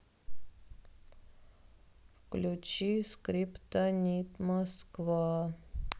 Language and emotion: Russian, sad